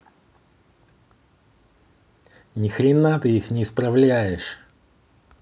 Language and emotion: Russian, angry